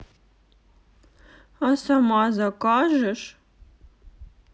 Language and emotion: Russian, sad